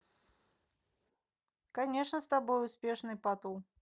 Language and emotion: Russian, neutral